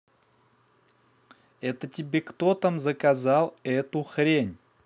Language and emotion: Russian, angry